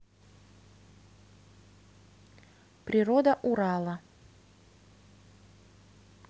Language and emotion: Russian, neutral